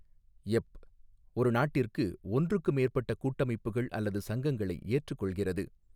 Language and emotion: Tamil, neutral